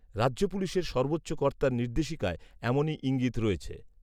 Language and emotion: Bengali, neutral